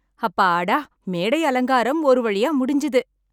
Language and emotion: Tamil, happy